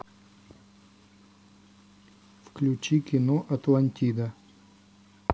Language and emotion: Russian, neutral